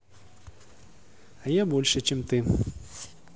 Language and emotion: Russian, neutral